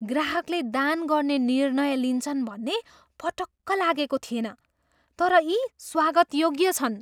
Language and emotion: Nepali, surprised